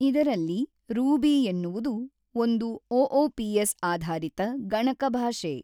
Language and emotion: Kannada, neutral